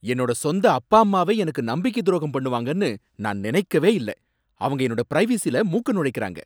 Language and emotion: Tamil, angry